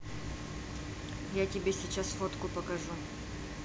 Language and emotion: Russian, neutral